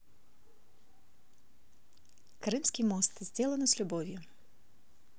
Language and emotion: Russian, neutral